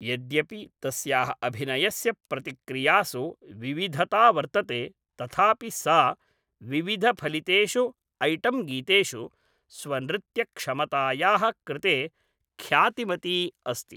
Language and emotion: Sanskrit, neutral